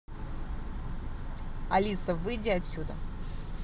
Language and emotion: Russian, angry